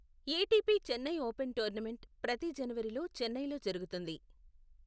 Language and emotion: Telugu, neutral